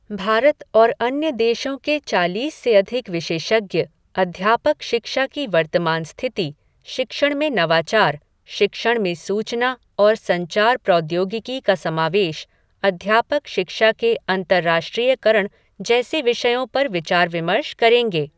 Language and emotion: Hindi, neutral